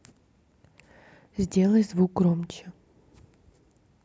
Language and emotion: Russian, neutral